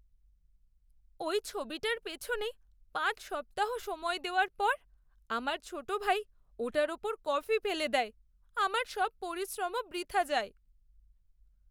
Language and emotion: Bengali, sad